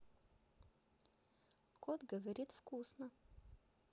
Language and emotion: Russian, positive